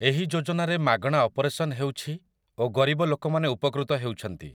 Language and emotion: Odia, neutral